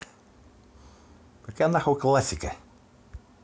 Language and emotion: Russian, angry